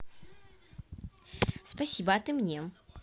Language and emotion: Russian, positive